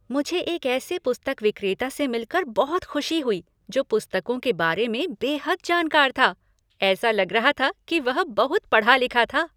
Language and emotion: Hindi, happy